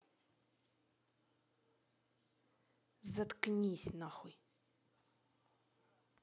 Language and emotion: Russian, angry